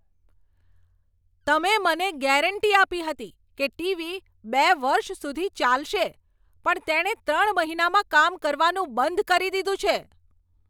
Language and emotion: Gujarati, angry